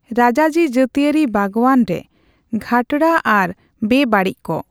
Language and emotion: Santali, neutral